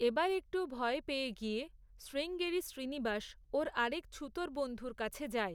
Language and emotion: Bengali, neutral